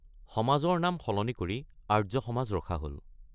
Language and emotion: Assamese, neutral